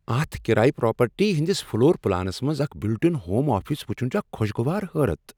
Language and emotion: Kashmiri, surprised